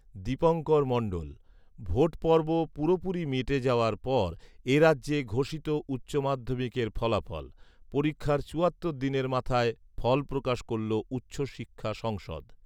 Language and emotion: Bengali, neutral